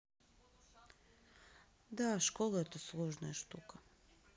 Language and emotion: Russian, sad